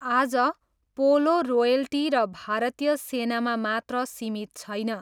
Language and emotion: Nepali, neutral